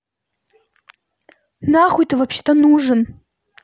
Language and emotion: Russian, angry